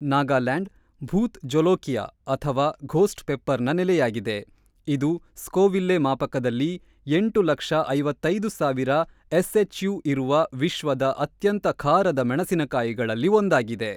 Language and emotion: Kannada, neutral